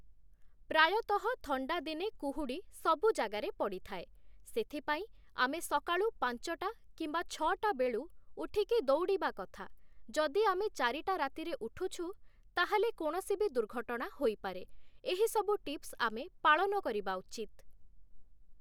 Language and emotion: Odia, neutral